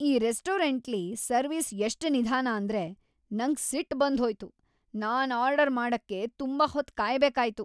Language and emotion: Kannada, angry